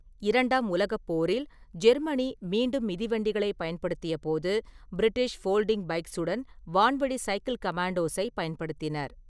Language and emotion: Tamil, neutral